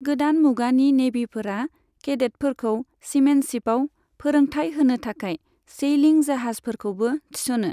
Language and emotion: Bodo, neutral